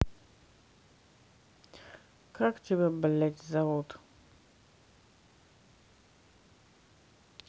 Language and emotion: Russian, angry